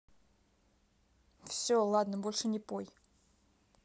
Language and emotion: Russian, neutral